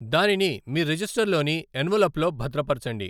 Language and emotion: Telugu, neutral